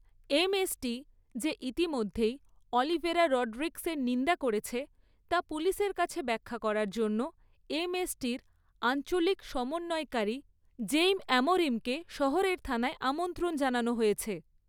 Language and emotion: Bengali, neutral